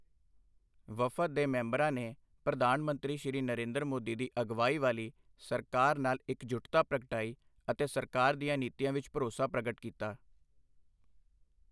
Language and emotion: Punjabi, neutral